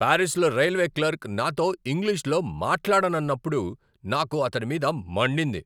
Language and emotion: Telugu, angry